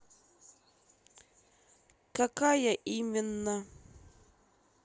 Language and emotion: Russian, angry